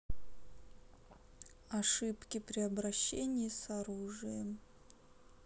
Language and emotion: Russian, sad